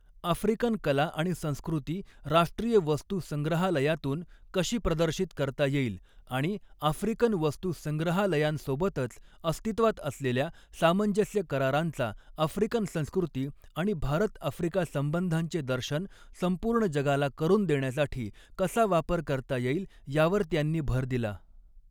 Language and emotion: Marathi, neutral